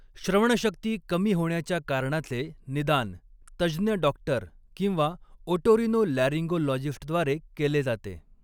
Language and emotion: Marathi, neutral